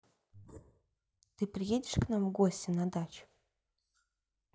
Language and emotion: Russian, neutral